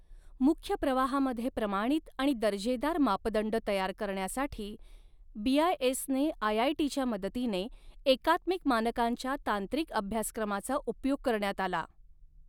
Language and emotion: Marathi, neutral